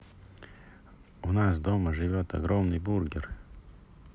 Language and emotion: Russian, neutral